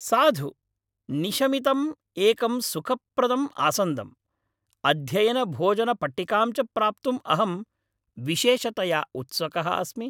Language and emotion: Sanskrit, happy